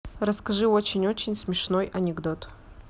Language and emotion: Russian, neutral